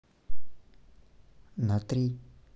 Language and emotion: Russian, neutral